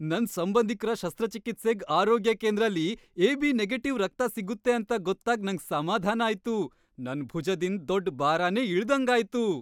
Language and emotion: Kannada, happy